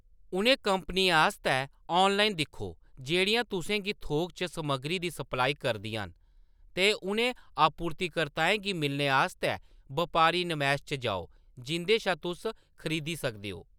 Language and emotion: Dogri, neutral